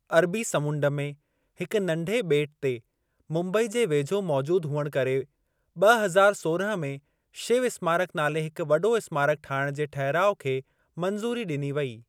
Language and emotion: Sindhi, neutral